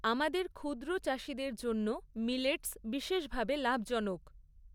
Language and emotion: Bengali, neutral